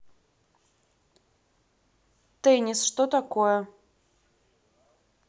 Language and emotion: Russian, neutral